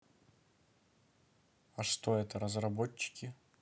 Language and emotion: Russian, neutral